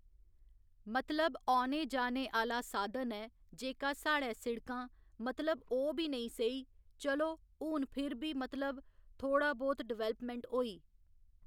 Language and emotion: Dogri, neutral